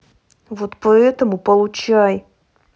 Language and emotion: Russian, angry